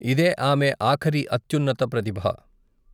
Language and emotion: Telugu, neutral